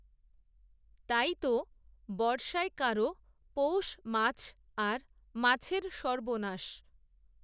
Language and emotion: Bengali, neutral